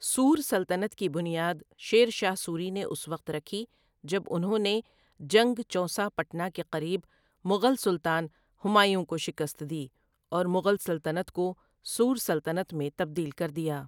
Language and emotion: Urdu, neutral